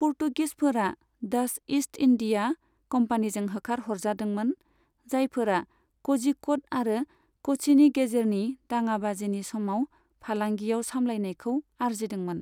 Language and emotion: Bodo, neutral